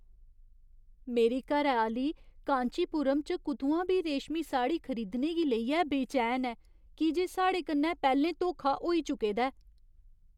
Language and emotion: Dogri, fearful